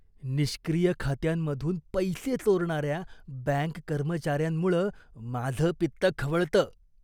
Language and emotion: Marathi, disgusted